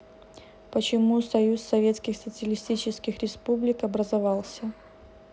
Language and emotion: Russian, neutral